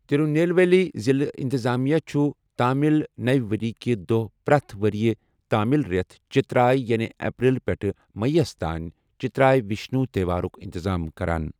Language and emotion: Kashmiri, neutral